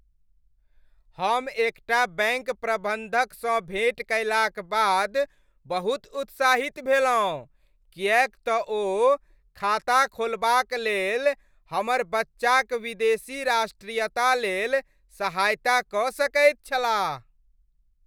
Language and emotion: Maithili, happy